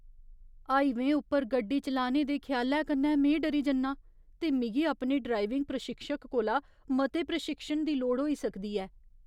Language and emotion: Dogri, fearful